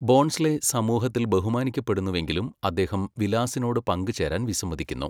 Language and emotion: Malayalam, neutral